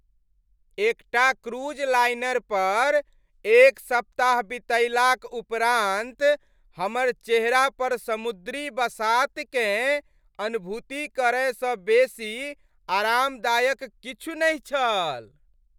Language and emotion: Maithili, happy